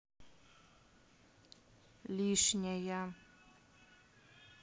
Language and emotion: Russian, neutral